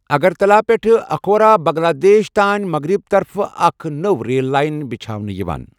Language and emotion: Kashmiri, neutral